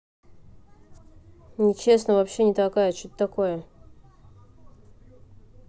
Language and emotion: Russian, neutral